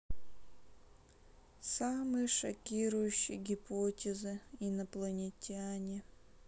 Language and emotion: Russian, sad